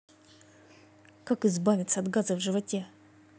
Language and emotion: Russian, angry